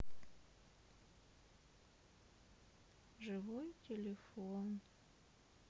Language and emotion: Russian, sad